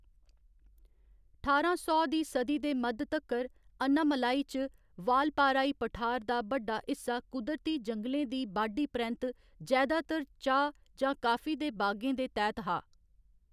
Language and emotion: Dogri, neutral